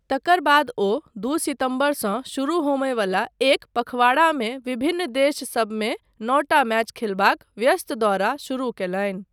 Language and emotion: Maithili, neutral